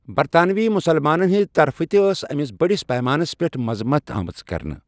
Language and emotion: Kashmiri, neutral